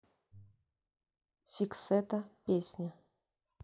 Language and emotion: Russian, neutral